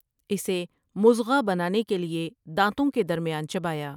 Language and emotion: Urdu, neutral